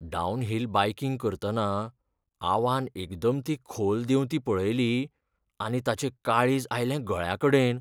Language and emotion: Goan Konkani, fearful